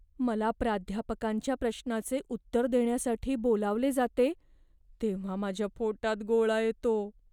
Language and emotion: Marathi, fearful